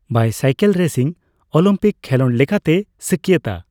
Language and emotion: Santali, neutral